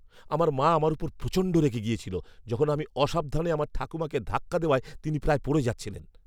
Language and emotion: Bengali, angry